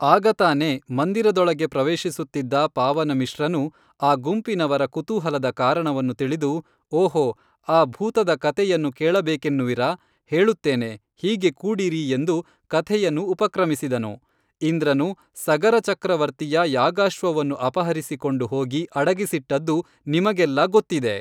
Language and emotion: Kannada, neutral